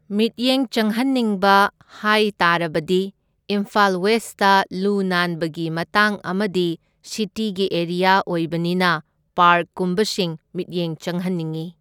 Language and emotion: Manipuri, neutral